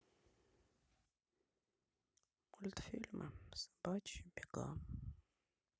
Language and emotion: Russian, sad